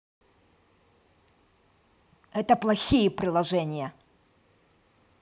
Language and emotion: Russian, angry